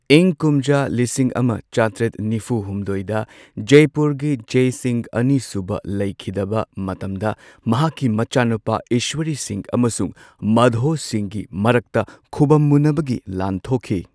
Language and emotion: Manipuri, neutral